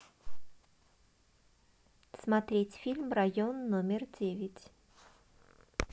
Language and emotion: Russian, neutral